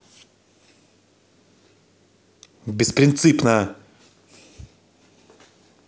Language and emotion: Russian, angry